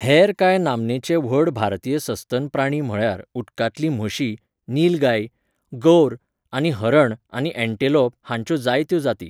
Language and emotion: Goan Konkani, neutral